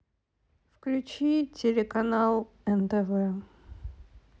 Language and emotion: Russian, sad